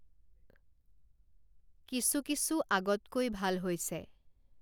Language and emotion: Assamese, neutral